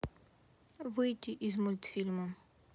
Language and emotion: Russian, neutral